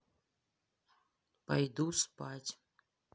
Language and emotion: Russian, neutral